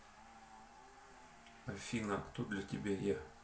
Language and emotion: Russian, neutral